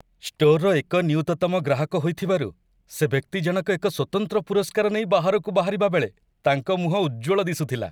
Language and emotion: Odia, happy